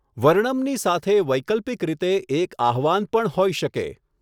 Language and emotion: Gujarati, neutral